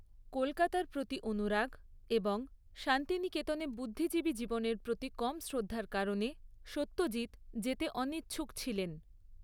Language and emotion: Bengali, neutral